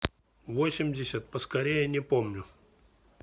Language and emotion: Russian, neutral